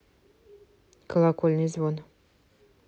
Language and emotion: Russian, neutral